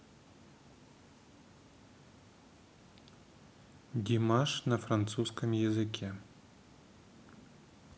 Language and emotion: Russian, neutral